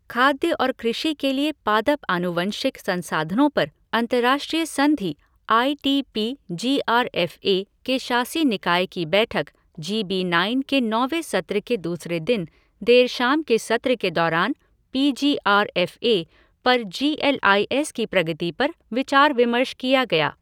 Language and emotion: Hindi, neutral